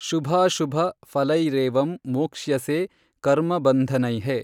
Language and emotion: Kannada, neutral